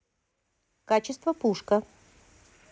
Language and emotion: Russian, positive